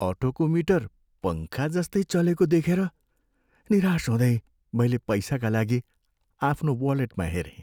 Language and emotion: Nepali, sad